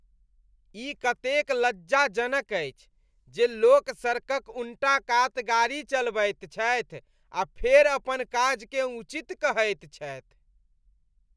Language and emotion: Maithili, disgusted